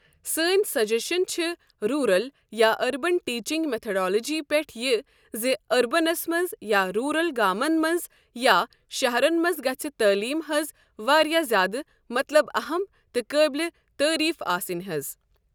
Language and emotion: Kashmiri, neutral